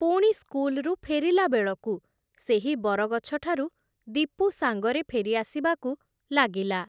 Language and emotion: Odia, neutral